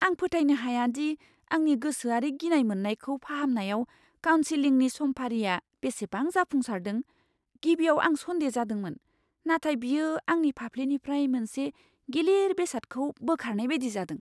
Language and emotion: Bodo, surprised